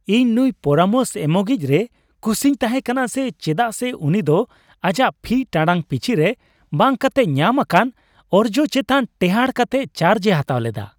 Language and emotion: Santali, happy